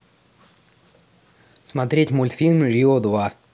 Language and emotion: Russian, neutral